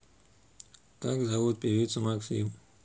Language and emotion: Russian, neutral